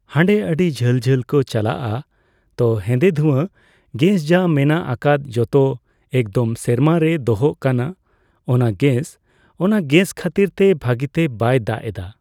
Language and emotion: Santali, neutral